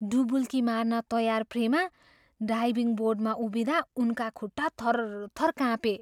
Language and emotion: Nepali, fearful